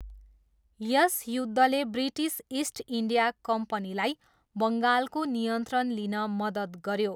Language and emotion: Nepali, neutral